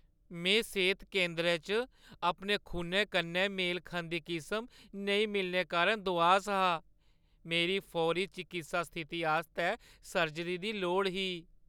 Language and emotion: Dogri, sad